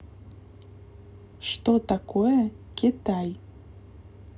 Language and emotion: Russian, neutral